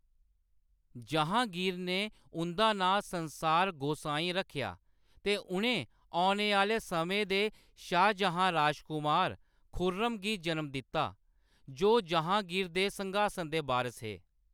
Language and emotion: Dogri, neutral